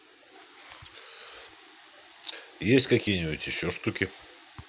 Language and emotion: Russian, neutral